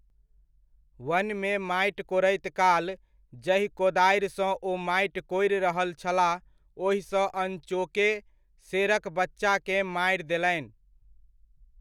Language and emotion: Maithili, neutral